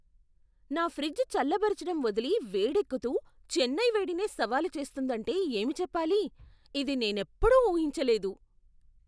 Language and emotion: Telugu, surprised